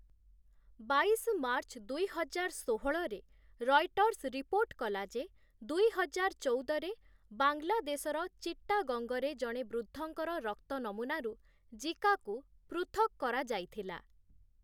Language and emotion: Odia, neutral